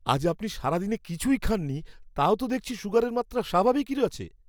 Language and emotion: Bengali, surprised